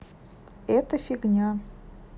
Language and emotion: Russian, neutral